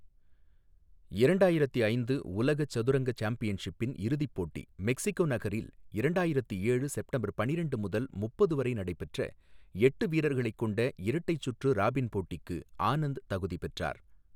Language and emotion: Tamil, neutral